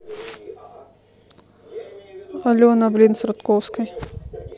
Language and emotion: Russian, neutral